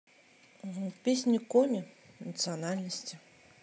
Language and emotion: Russian, neutral